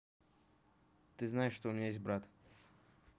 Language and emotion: Russian, neutral